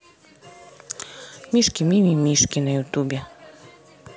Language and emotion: Russian, neutral